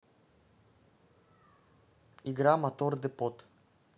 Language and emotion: Russian, neutral